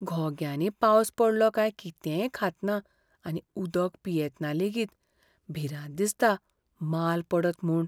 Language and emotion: Goan Konkani, fearful